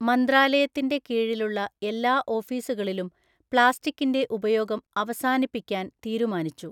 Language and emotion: Malayalam, neutral